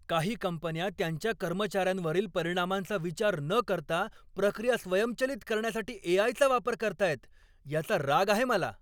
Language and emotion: Marathi, angry